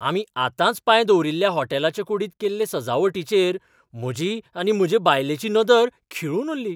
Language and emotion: Goan Konkani, surprised